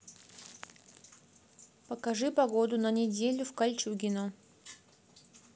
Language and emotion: Russian, neutral